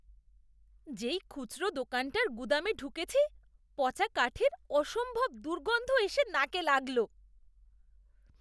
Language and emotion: Bengali, disgusted